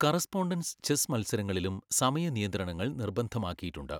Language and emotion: Malayalam, neutral